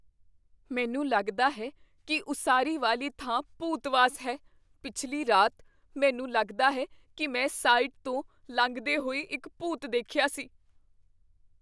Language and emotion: Punjabi, fearful